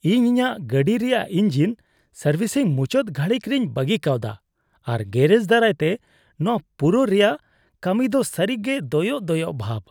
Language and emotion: Santali, disgusted